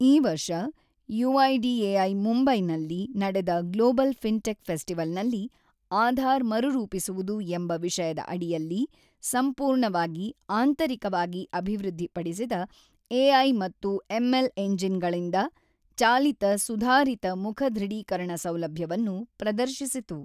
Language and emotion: Kannada, neutral